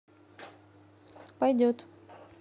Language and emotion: Russian, neutral